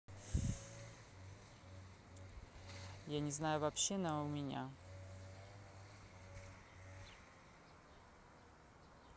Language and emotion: Russian, neutral